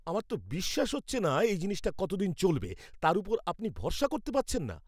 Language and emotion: Bengali, angry